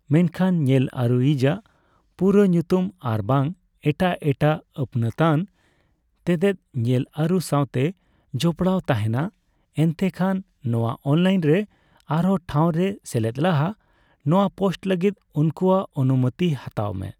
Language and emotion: Santali, neutral